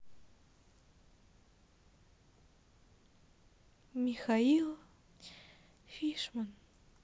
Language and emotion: Russian, sad